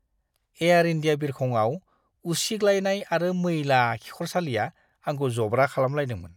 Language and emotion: Bodo, disgusted